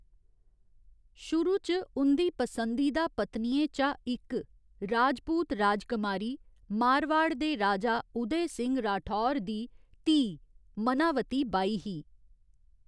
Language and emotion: Dogri, neutral